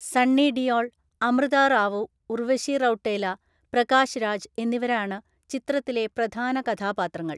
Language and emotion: Malayalam, neutral